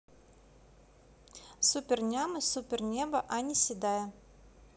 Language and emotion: Russian, neutral